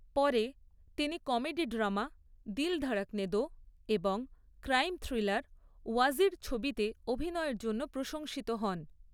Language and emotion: Bengali, neutral